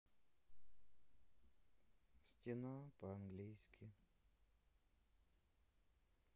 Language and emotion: Russian, sad